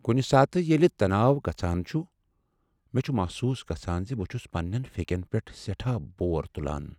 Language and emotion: Kashmiri, sad